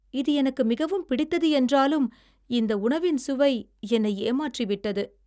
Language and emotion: Tamil, sad